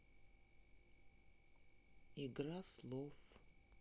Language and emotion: Russian, sad